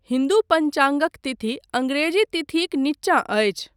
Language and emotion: Maithili, neutral